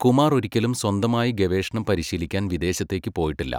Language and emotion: Malayalam, neutral